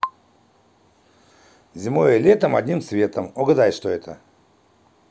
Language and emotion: Russian, positive